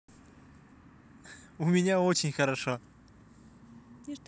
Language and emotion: Russian, positive